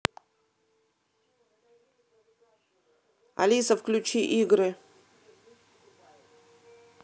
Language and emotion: Russian, neutral